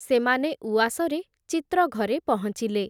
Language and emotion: Odia, neutral